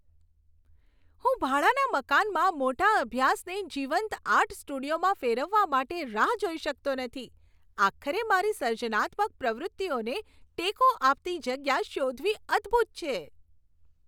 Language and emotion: Gujarati, happy